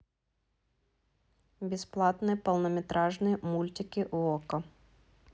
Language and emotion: Russian, neutral